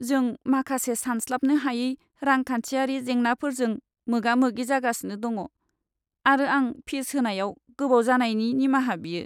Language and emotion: Bodo, sad